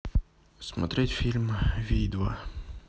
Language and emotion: Russian, sad